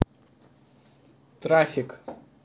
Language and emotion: Russian, neutral